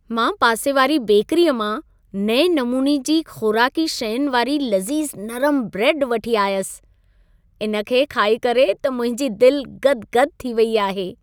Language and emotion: Sindhi, happy